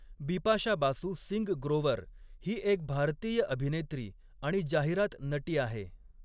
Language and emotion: Marathi, neutral